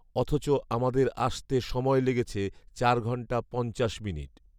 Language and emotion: Bengali, neutral